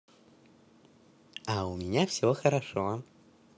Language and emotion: Russian, positive